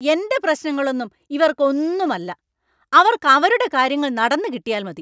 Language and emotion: Malayalam, angry